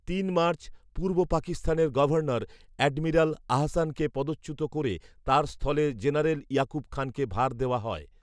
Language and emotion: Bengali, neutral